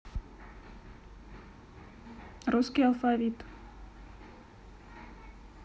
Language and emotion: Russian, neutral